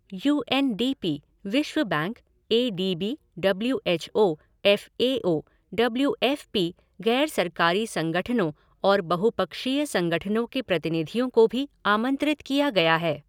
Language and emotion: Hindi, neutral